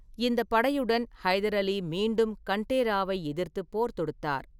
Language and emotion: Tamil, neutral